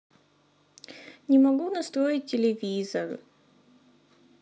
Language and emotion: Russian, sad